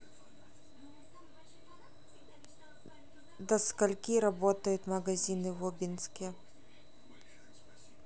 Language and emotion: Russian, neutral